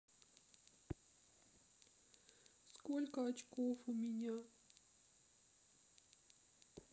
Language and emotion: Russian, sad